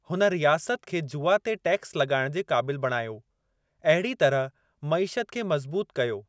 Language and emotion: Sindhi, neutral